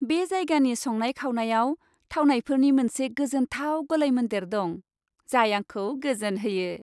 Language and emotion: Bodo, happy